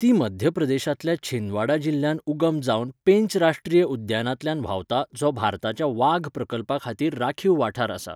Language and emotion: Goan Konkani, neutral